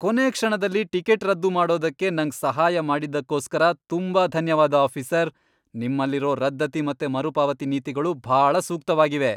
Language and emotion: Kannada, happy